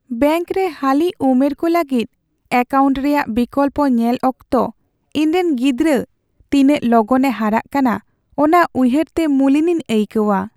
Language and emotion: Santali, sad